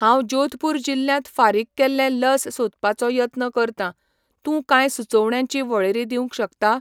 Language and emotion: Goan Konkani, neutral